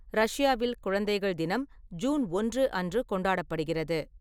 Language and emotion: Tamil, neutral